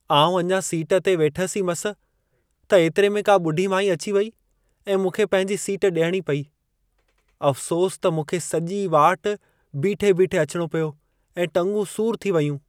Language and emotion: Sindhi, sad